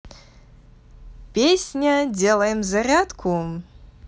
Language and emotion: Russian, positive